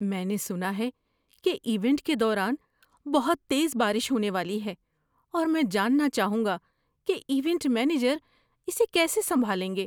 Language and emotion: Urdu, fearful